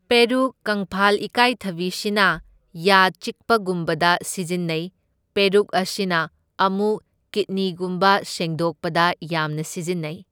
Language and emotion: Manipuri, neutral